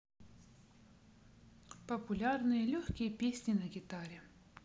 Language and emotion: Russian, neutral